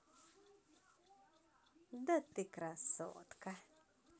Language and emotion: Russian, positive